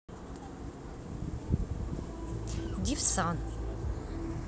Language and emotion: Russian, neutral